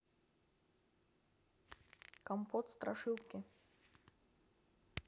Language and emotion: Russian, neutral